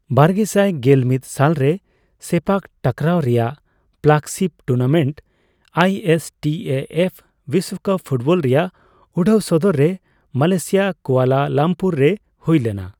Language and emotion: Santali, neutral